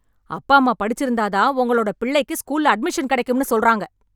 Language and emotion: Tamil, angry